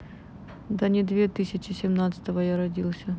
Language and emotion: Russian, neutral